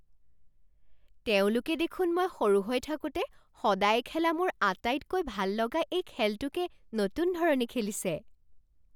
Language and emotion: Assamese, surprised